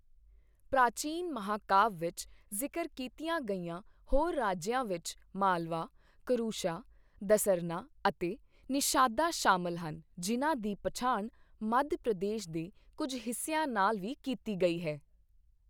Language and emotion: Punjabi, neutral